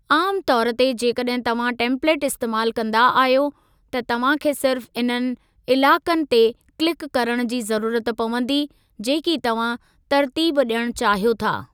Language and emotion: Sindhi, neutral